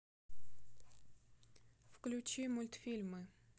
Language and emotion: Russian, neutral